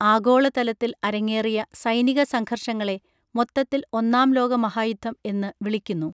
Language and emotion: Malayalam, neutral